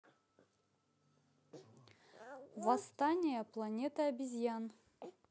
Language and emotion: Russian, neutral